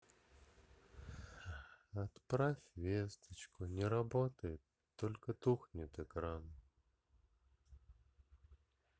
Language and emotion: Russian, sad